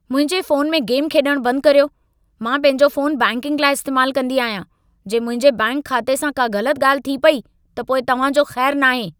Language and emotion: Sindhi, angry